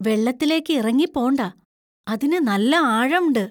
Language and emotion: Malayalam, fearful